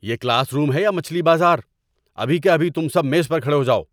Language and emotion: Urdu, angry